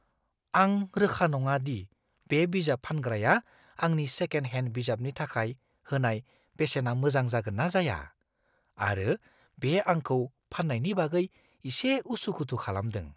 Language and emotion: Bodo, fearful